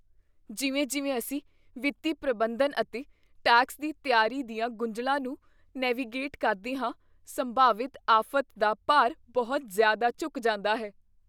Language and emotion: Punjabi, fearful